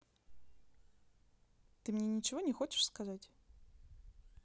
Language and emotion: Russian, neutral